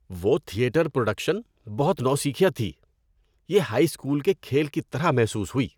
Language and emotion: Urdu, disgusted